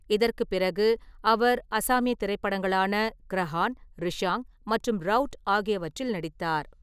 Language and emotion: Tamil, neutral